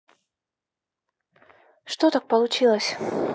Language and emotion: Russian, sad